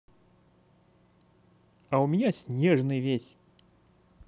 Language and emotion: Russian, positive